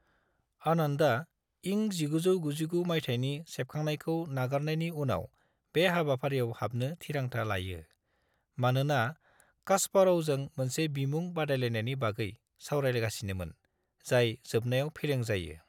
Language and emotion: Bodo, neutral